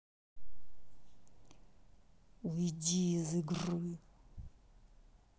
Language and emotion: Russian, angry